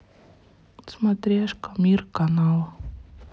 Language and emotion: Russian, sad